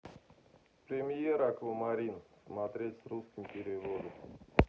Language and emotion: Russian, neutral